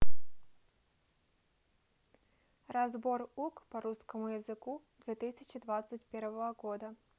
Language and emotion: Russian, neutral